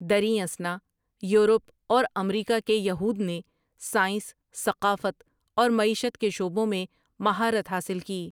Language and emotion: Urdu, neutral